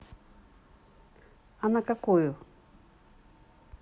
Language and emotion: Russian, neutral